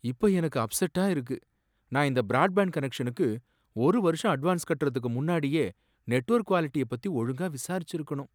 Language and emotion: Tamil, sad